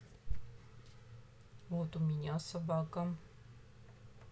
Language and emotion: Russian, neutral